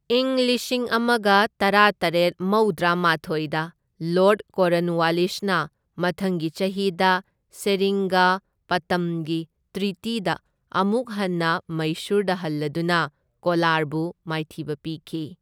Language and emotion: Manipuri, neutral